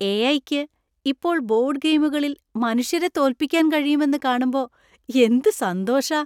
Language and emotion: Malayalam, happy